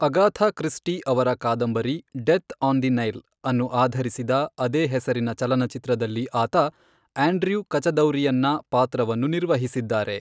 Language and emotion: Kannada, neutral